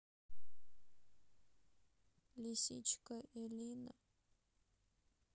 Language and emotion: Russian, sad